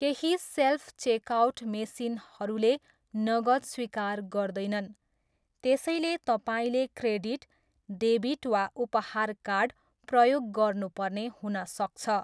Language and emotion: Nepali, neutral